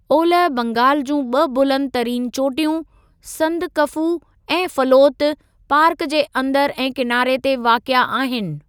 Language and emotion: Sindhi, neutral